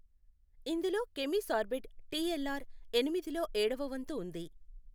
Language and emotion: Telugu, neutral